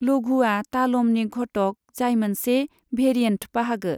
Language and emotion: Bodo, neutral